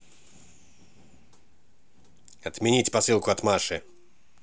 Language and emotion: Russian, angry